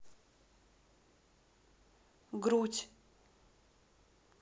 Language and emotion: Russian, neutral